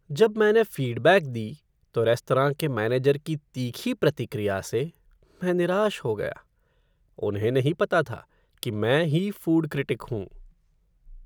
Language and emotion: Hindi, sad